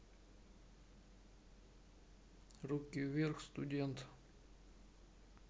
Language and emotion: Russian, neutral